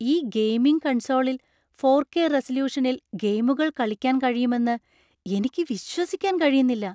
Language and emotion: Malayalam, surprised